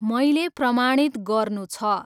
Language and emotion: Nepali, neutral